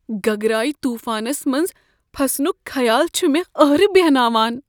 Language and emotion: Kashmiri, fearful